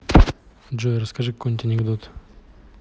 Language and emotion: Russian, neutral